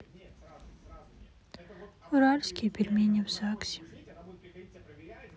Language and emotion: Russian, sad